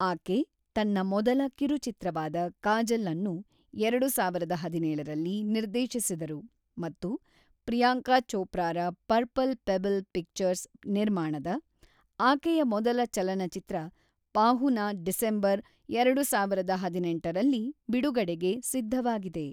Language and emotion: Kannada, neutral